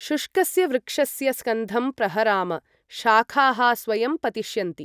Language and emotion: Sanskrit, neutral